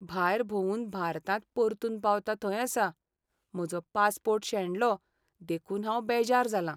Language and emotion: Goan Konkani, sad